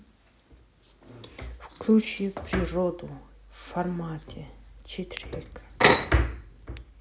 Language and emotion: Russian, neutral